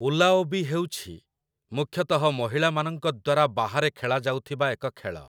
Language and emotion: Odia, neutral